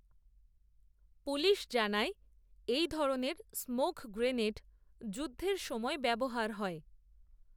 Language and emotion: Bengali, neutral